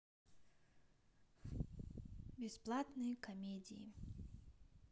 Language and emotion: Russian, neutral